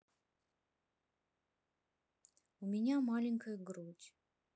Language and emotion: Russian, sad